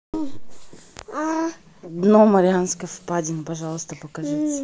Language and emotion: Russian, neutral